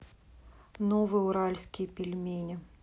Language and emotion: Russian, neutral